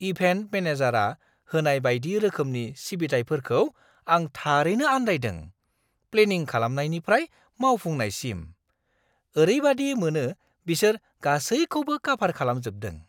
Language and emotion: Bodo, surprised